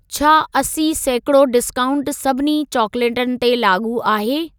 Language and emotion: Sindhi, neutral